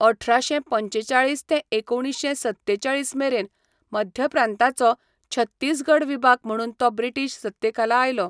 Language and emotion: Goan Konkani, neutral